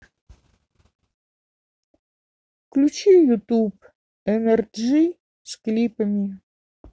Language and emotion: Russian, neutral